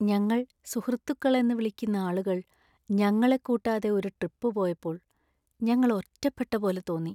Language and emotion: Malayalam, sad